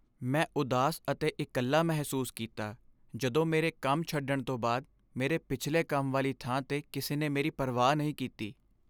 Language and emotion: Punjabi, sad